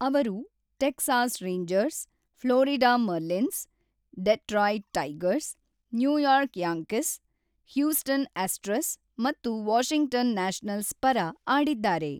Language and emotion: Kannada, neutral